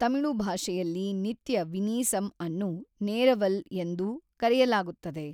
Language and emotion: Kannada, neutral